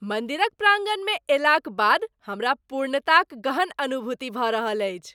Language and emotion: Maithili, happy